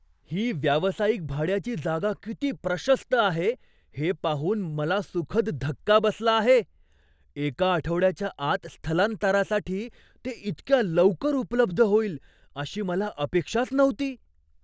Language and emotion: Marathi, surprised